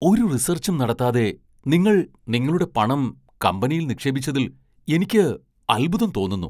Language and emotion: Malayalam, surprised